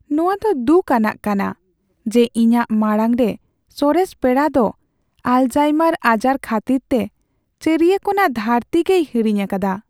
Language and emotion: Santali, sad